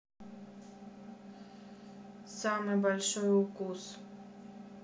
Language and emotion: Russian, neutral